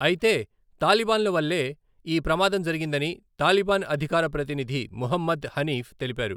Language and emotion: Telugu, neutral